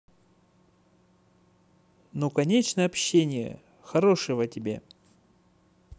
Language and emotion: Russian, positive